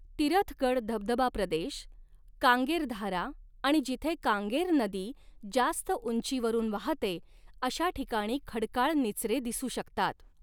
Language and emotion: Marathi, neutral